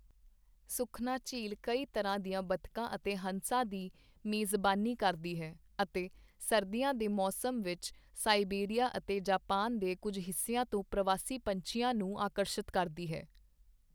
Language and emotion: Punjabi, neutral